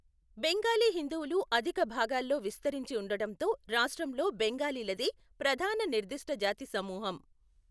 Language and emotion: Telugu, neutral